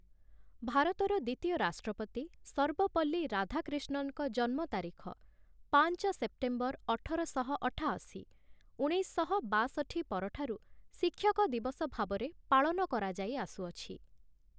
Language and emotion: Odia, neutral